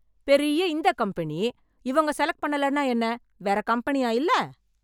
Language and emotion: Tamil, angry